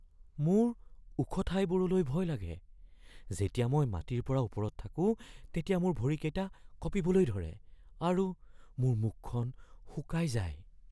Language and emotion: Assamese, fearful